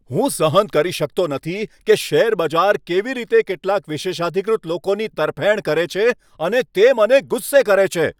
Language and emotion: Gujarati, angry